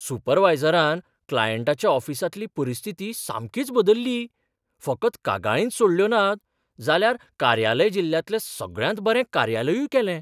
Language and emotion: Goan Konkani, surprised